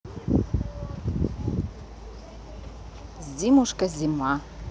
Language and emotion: Russian, neutral